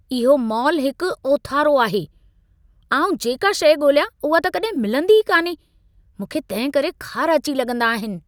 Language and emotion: Sindhi, angry